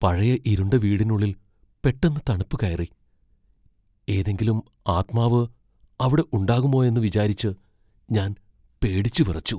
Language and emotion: Malayalam, fearful